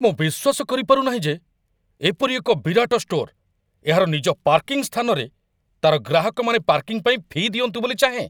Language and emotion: Odia, angry